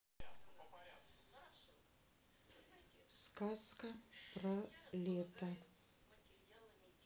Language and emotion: Russian, neutral